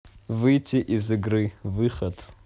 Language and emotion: Russian, neutral